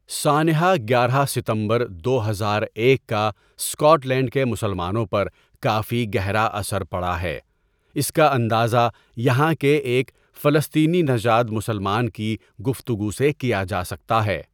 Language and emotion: Urdu, neutral